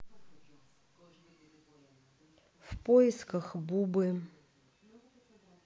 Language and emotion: Russian, neutral